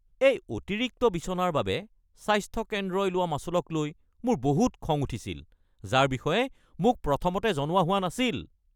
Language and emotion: Assamese, angry